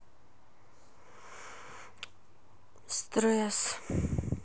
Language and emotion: Russian, sad